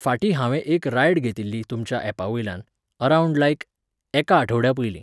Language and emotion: Goan Konkani, neutral